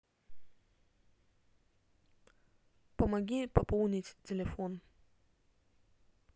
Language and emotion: Russian, neutral